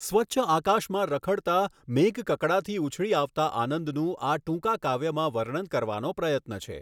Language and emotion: Gujarati, neutral